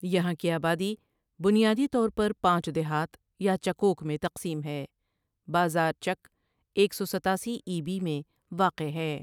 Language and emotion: Urdu, neutral